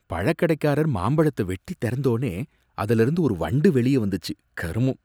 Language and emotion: Tamil, disgusted